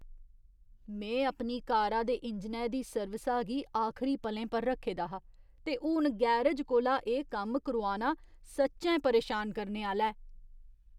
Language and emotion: Dogri, disgusted